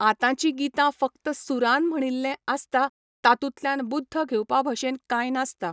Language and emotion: Goan Konkani, neutral